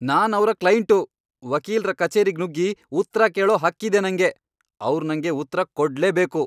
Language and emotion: Kannada, angry